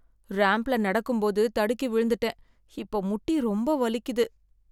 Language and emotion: Tamil, sad